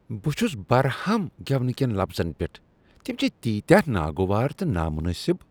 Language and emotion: Kashmiri, disgusted